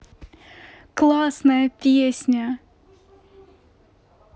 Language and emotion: Russian, positive